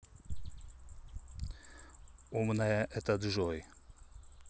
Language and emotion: Russian, neutral